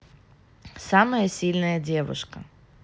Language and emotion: Russian, neutral